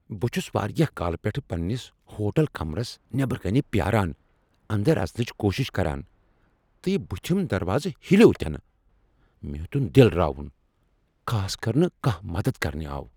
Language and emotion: Kashmiri, angry